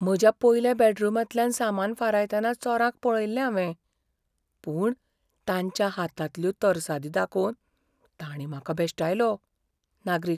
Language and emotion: Goan Konkani, fearful